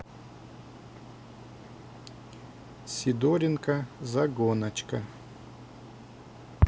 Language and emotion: Russian, neutral